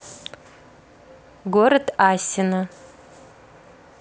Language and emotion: Russian, neutral